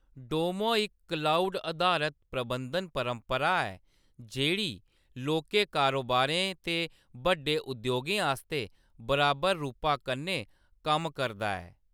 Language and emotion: Dogri, neutral